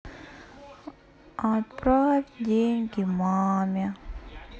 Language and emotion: Russian, sad